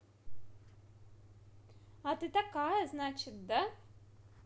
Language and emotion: Russian, positive